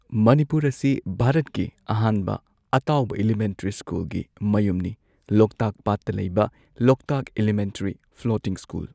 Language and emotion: Manipuri, neutral